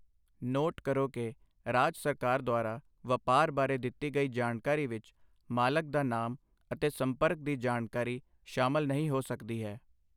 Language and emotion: Punjabi, neutral